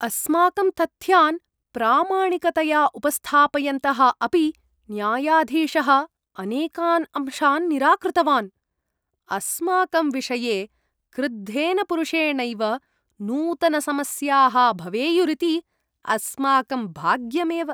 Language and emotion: Sanskrit, disgusted